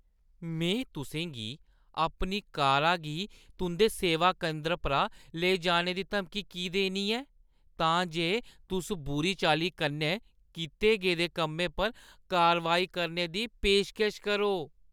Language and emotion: Dogri, disgusted